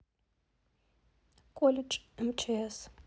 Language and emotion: Russian, neutral